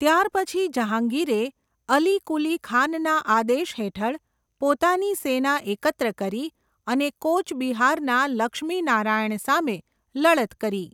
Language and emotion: Gujarati, neutral